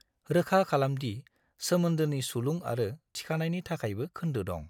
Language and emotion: Bodo, neutral